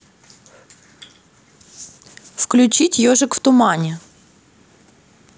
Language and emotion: Russian, neutral